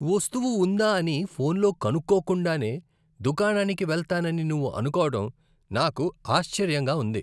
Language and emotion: Telugu, disgusted